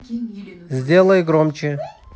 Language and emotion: Russian, neutral